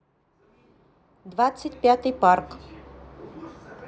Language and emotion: Russian, neutral